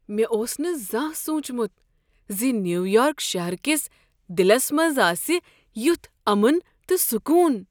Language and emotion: Kashmiri, surprised